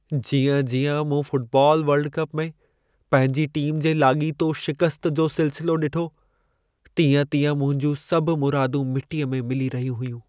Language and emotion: Sindhi, sad